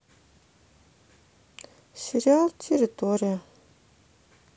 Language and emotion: Russian, sad